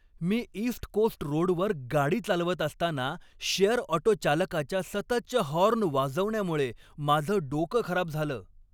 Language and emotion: Marathi, angry